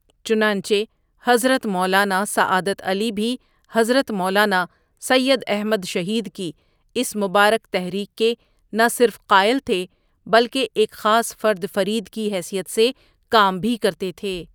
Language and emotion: Urdu, neutral